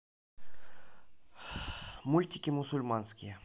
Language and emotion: Russian, neutral